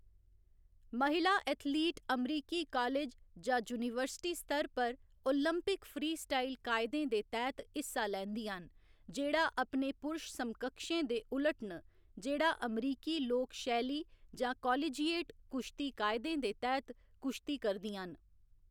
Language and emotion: Dogri, neutral